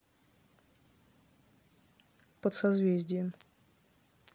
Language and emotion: Russian, neutral